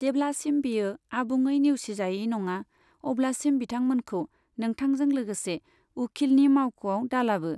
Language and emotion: Bodo, neutral